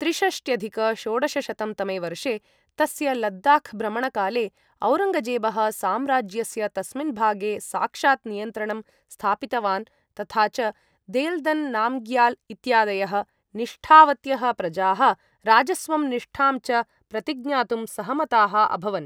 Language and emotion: Sanskrit, neutral